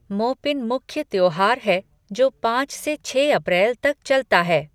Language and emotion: Hindi, neutral